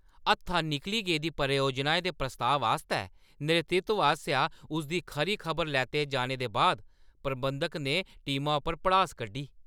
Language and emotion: Dogri, angry